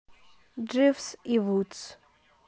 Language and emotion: Russian, neutral